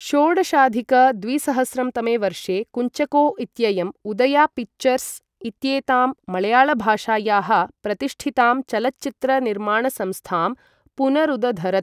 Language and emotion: Sanskrit, neutral